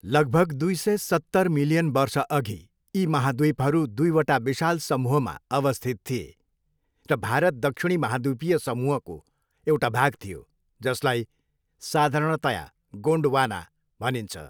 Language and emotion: Nepali, neutral